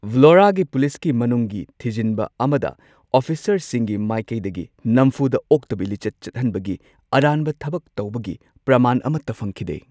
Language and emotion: Manipuri, neutral